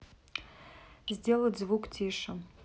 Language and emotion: Russian, neutral